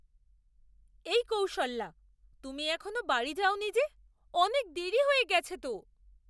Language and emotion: Bengali, surprised